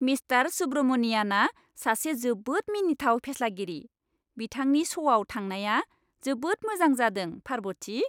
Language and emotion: Bodo, happy